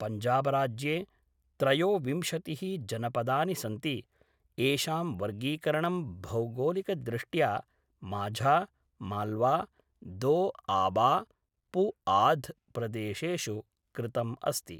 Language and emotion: Sanskrit, neutral